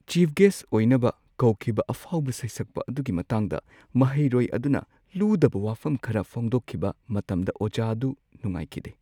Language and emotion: Manipuri, sad